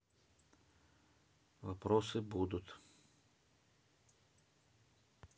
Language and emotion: Russian, neutral